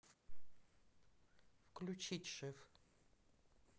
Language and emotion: Russian, neutral